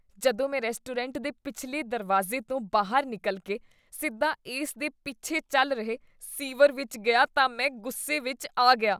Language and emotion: Punjabi, disgusted